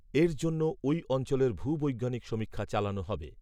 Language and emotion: Bengali, neutral